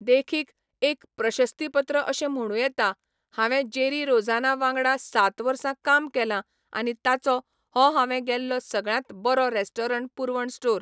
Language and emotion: Goan Konkani, neutral